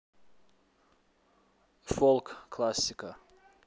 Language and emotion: Russian, neutral